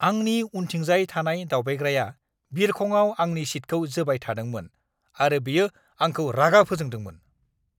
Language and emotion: Bodo, angry